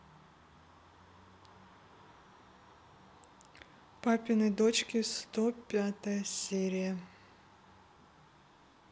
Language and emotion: Russian, neutral